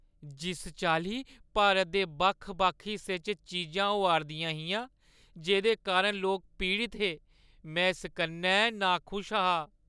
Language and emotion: Dogri, sad